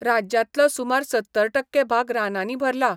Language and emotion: Goan Konkani, neutral